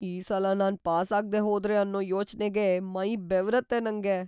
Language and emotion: Kannada, fearful